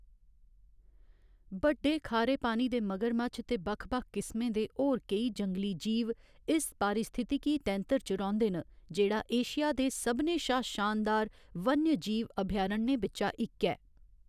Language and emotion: Dogri, neutral